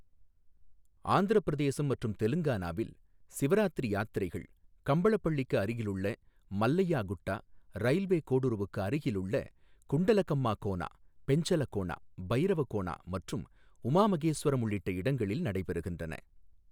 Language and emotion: Tamil, neutral